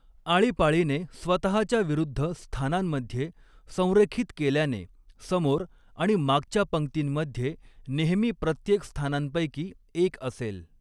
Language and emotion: Marathi, neutral